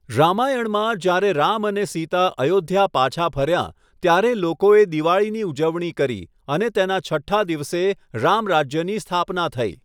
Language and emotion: Gujarati, neutral